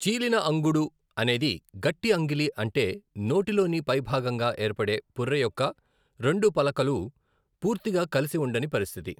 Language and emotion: Telugu, neutral